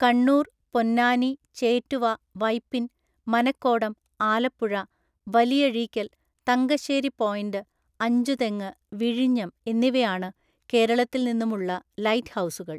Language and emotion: Malayalam, neutral